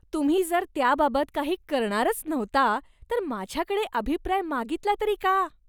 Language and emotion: Marathi, disgusted